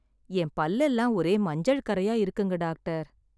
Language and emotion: Tamil, sad